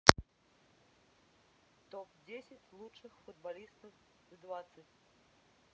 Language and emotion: Russian, neutral